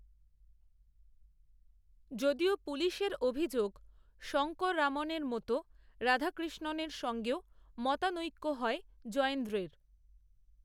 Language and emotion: Bengali, neutral